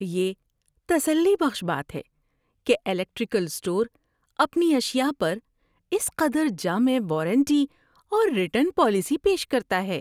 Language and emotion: Urdu, happy